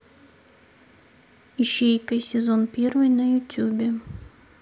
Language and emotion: Russian, neutral